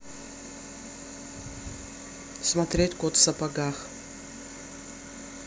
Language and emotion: Russian, neutral